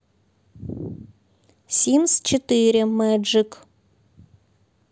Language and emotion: Russian, neutral